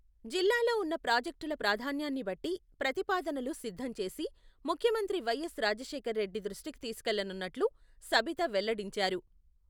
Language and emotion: Telugu, neutral